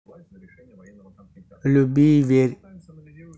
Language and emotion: Russian, neutral